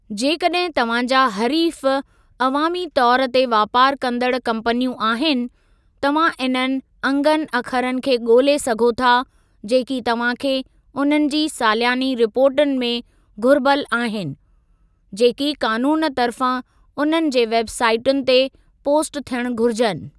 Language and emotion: Sindhi, neutral